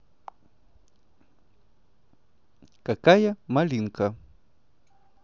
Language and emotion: Russian, positive